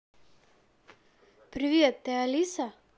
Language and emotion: Russian, positive